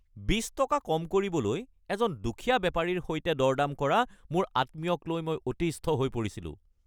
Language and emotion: Assamese, angry